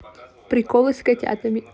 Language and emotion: Russian, positive